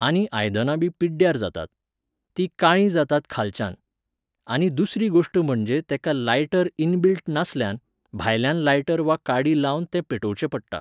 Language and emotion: Goan Konkani, neutral